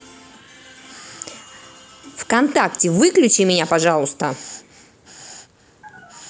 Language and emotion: Russian, angry